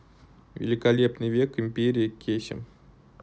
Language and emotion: Russian, neutral